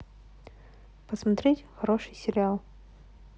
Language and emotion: Russian, neutral